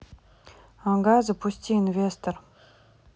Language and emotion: Russian, neutral